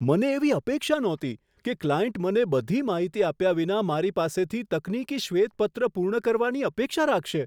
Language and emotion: Gujarati, surprised